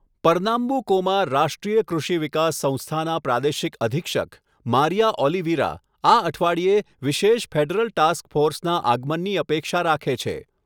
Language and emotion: Gujarati, neutral